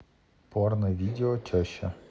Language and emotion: Russian, neutral